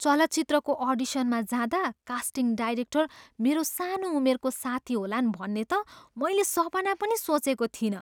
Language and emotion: Nepali, surprised